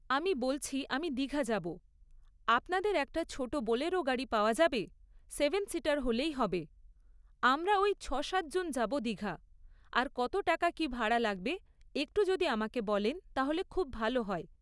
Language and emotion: Bengali, neutral